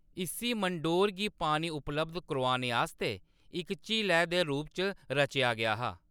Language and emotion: Dogri, neutral